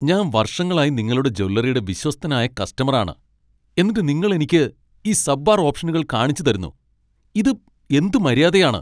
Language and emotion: Malayalam, angry